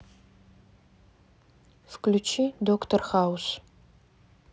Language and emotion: Russian, neutral